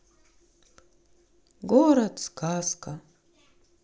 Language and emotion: Russian, sad